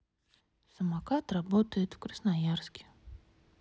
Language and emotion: Russian, sad